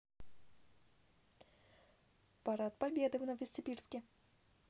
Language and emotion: Russian, neutral